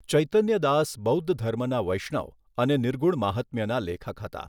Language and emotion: Gujarati, neutral